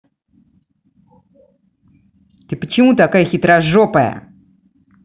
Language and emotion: Russian, angry